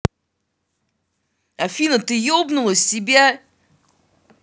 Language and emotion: Russian, angry